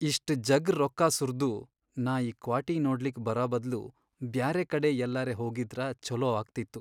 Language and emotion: Kannada, sad